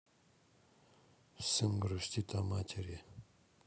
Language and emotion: Russian, sad